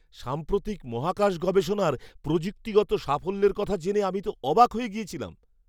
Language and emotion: Bengali, surprised